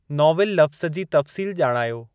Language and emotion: Sindhi, neutral